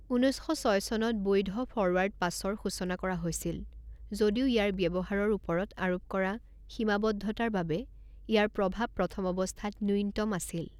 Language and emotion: Assamese, neutral